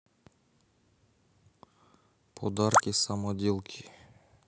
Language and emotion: Russian, neutral